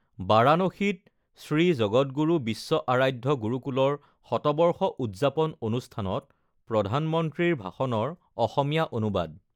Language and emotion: Assamese, neutral